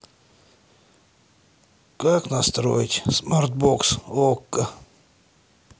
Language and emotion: Russian, sad